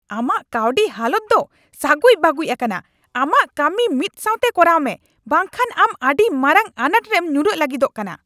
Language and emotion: Santali, angry